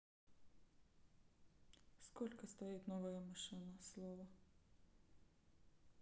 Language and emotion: Russian, neutral